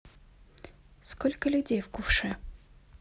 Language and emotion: Russian, neutral